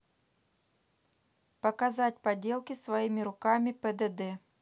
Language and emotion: Russian, neutral